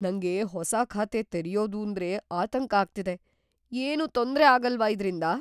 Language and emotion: Kannada, fearful